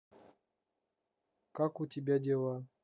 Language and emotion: Russian, neutral